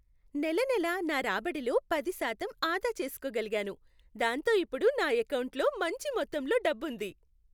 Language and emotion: Telugu, happy